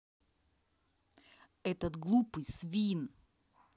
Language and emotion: Russian, angry